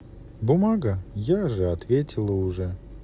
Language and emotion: Russian, neutral